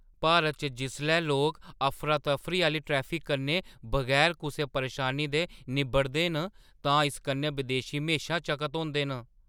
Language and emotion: Dogri, surprised